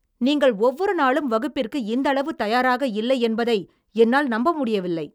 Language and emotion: Tamil, angry